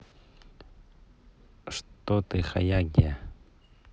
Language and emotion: Russian, neutral